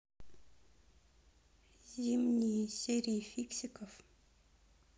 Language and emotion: Russian, neutral